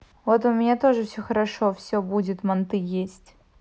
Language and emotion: Russian, neutral